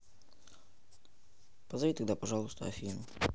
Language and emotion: Russian, neutral